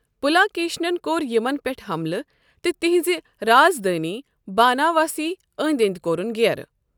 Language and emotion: Kashmiri, neutral